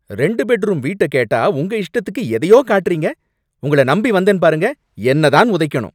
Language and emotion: Tamil, angry